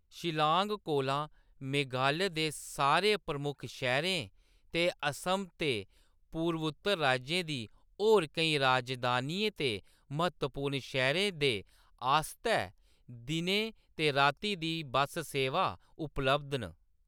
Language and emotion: Dogri, neutral